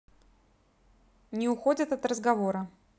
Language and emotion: Russian, neutral